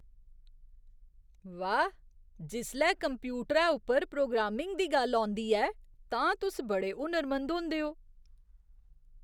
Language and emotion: Dogri, surprised